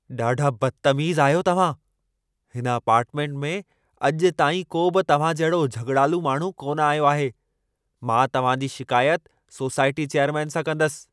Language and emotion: Sindhi, angry